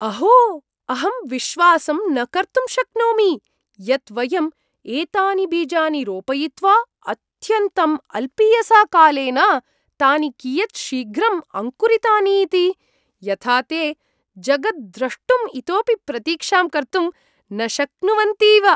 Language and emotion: Sanskrit, surprised